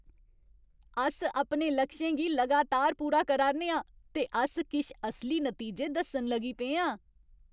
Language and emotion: Dogri, happy